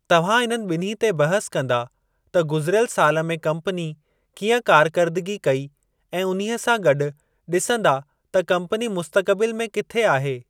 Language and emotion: Sindhi, neutral